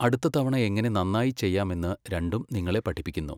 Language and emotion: Malayalam, neutral